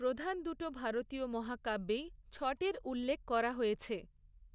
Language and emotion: Bengali, neutral